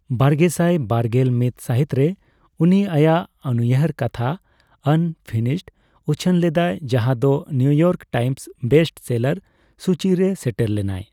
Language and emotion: Santali, neutral